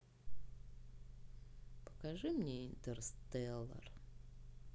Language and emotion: Russian, neutral